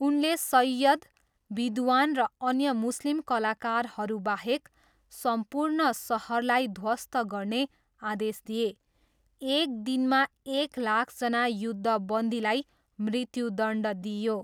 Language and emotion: Nepali, neutral